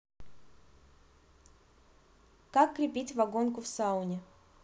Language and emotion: Russian, neutral